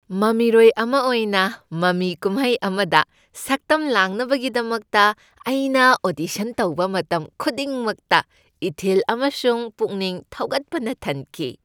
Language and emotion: Manipuri, happy